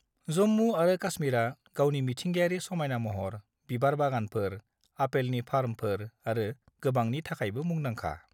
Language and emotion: Bodo, neutral